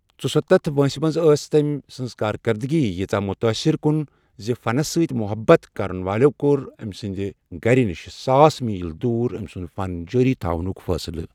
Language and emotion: Kashmiri, neutral